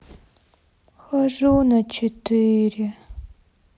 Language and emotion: Russian, sad